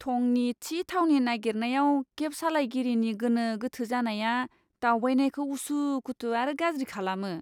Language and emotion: Bodo, disgusted